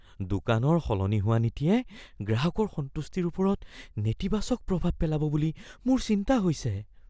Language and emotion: Assamese, fearful